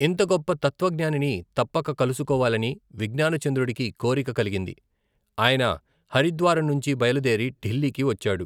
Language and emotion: Telugu, neutral